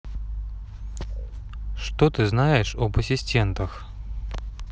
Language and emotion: Russian, neutral